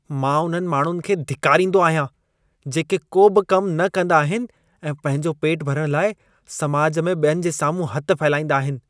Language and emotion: Sindhi, disgusted